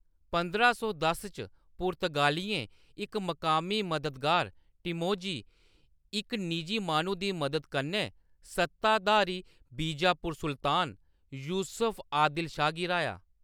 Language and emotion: Dogri, neutral